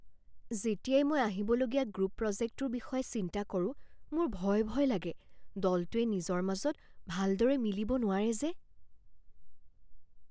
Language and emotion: Assamese, fearful